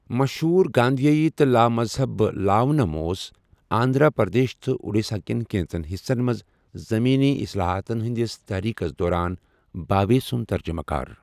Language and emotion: Kashmiri, neutral